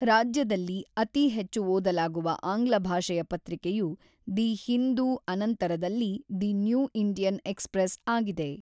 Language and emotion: Kannada, neutral